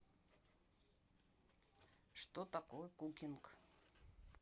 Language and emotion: Russian, neutral